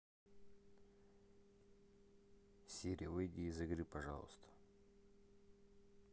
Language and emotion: Russian, neutral